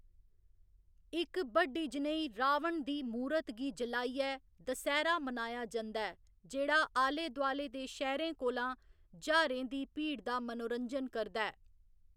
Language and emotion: Dogri, neutral